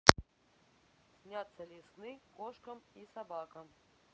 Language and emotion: Russian, neutral